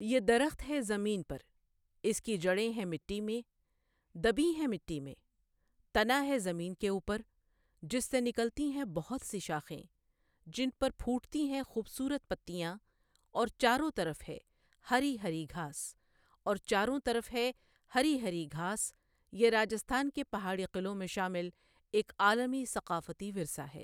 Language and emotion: Urdu, neutral